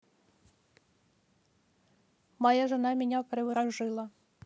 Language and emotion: Russian, neutral